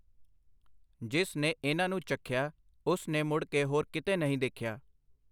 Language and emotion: Punjabi, neutral